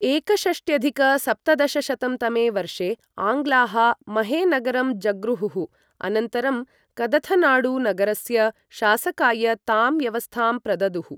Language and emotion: Sanskrit, neutral